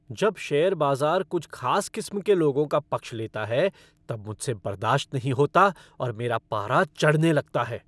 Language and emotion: Hindi, angry